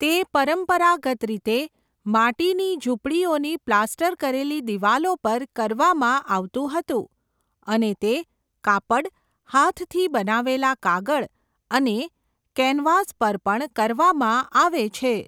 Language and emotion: Gujarati, neutral